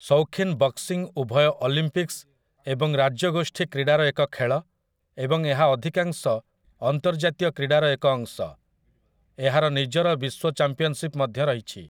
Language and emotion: Odia, neutral